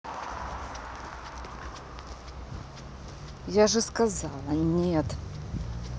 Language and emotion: Russian, angry